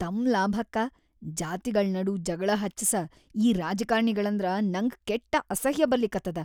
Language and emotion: Kannada, disgusted